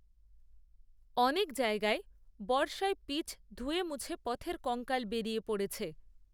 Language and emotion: Bengali, neutral